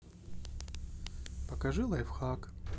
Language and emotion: Russian, neutral